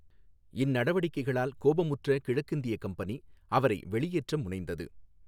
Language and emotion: Tamil, neutral